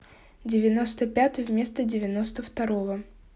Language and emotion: Russian, neutral